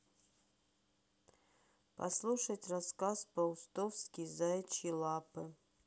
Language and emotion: Russian, neutral